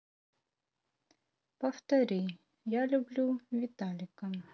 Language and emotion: Russian, neutral